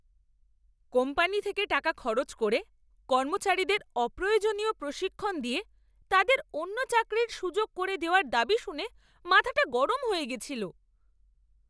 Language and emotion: Bengali, angry